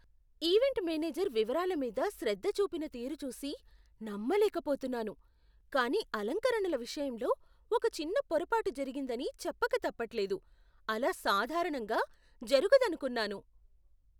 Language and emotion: Telugu, surprised